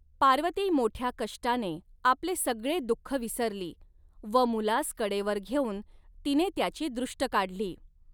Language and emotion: Marathi, neutral